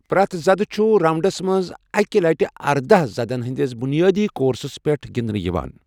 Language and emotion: Kashmiri, neutral